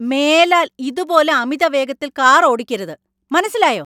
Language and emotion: Malayalam, angry